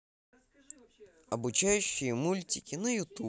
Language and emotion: Russian, positive